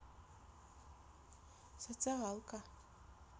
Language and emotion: Russian, neutral